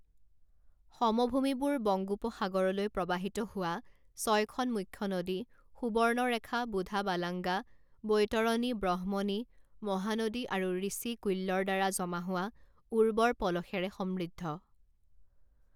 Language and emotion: Assamese, neutral